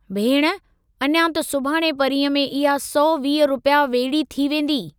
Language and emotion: Sindhi, neutral